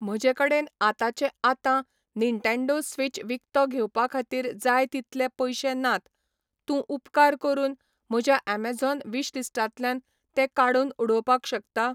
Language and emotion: Goan Konkani, neutral